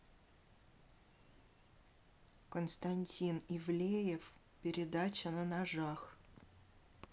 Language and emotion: Russian, neutral